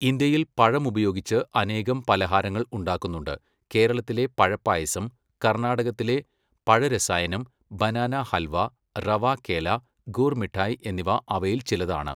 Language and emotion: Malayalam, neutral